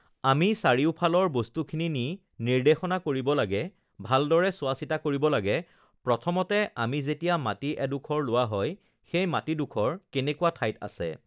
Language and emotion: Assamese, neutral